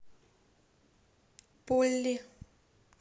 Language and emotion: Russian, neutral